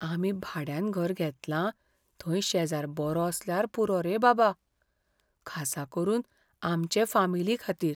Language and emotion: Goan Konkani, fearful